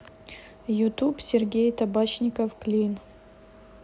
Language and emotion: Russian, neutral